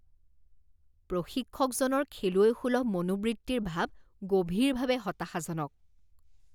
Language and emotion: Assamese, disgusted